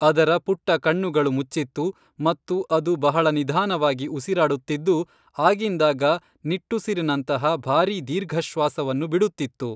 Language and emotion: Kannada, neutral